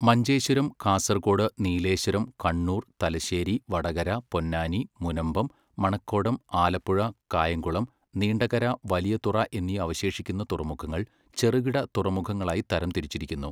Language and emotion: Malayalam, neutral